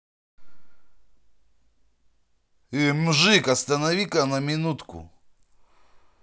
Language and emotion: Russian, angry